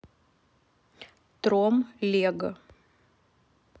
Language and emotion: Russian, neutral